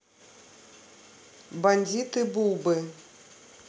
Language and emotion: Russian, neutral